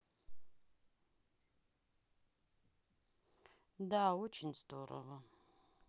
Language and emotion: Russian, sad